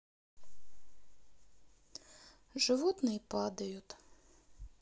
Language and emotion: Russian, sad